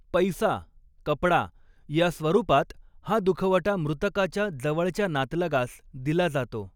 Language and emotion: Marathi, neutral